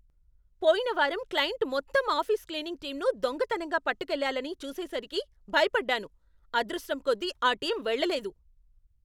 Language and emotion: Telugu, angry